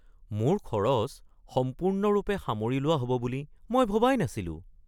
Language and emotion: Assamese, surprised